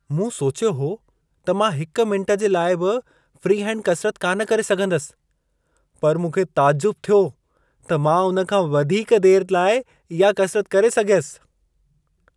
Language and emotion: Sindhi, surprised